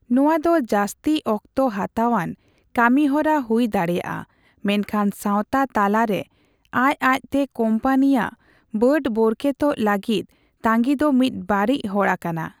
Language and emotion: Santali, neutral